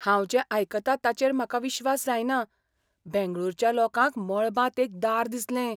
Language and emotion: Goan Konkani, surprised